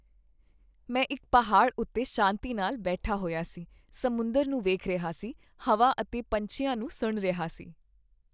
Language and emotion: Punjabi, happy